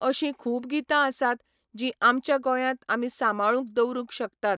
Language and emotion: Goan Konkani, neutral